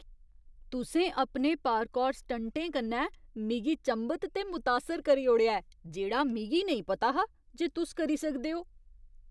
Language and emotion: Dogri, surprised